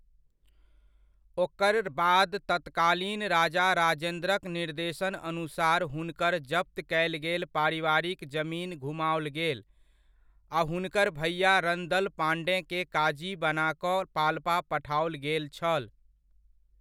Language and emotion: Maithili, neutral